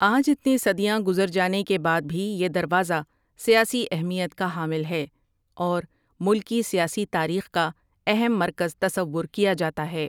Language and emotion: Urdu, neutral